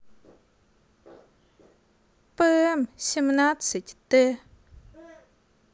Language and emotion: Russian, neutral